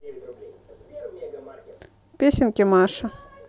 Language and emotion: Russian, neutral